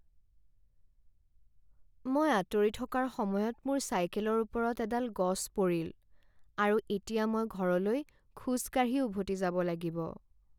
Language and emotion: Assamese, sad